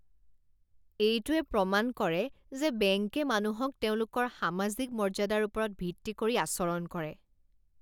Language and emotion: Assamese, disgusted